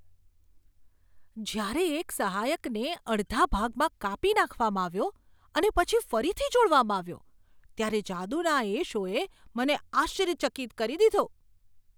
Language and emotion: Gujarati, surprised